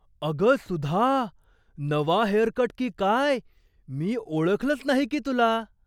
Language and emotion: Marathi, surprised